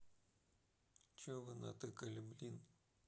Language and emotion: Russian, neutral